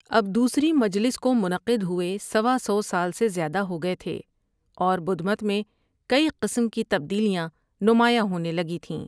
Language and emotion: Urdu, neutral